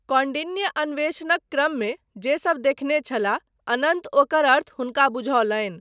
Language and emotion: Maithili, neutral